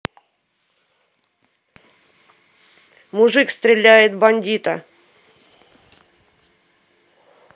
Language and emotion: Russian, angry